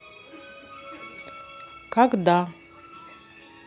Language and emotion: Russian, neutral